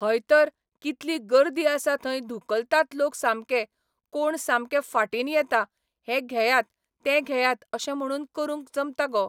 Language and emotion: Goan Konkani, neutral